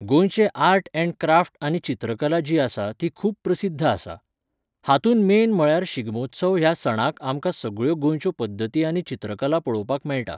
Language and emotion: Goan Konkani, neutral